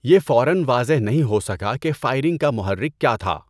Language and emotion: Urdu, neutral